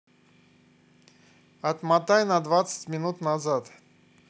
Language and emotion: Russian, neutral